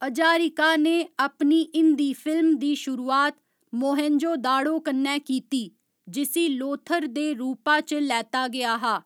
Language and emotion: Dogri, neutral